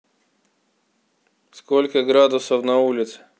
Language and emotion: Russian, neutral